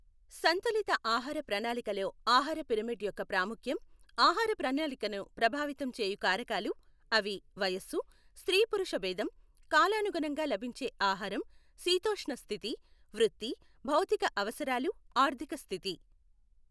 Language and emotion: Telugu, neutral